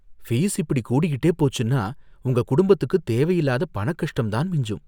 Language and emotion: Tamil, fearful